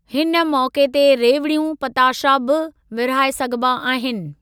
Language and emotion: Sindhi, neutral